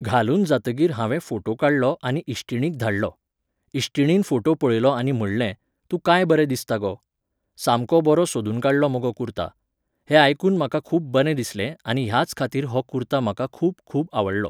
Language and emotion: Goan Konkani, neutral